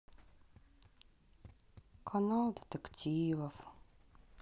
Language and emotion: Russian, sad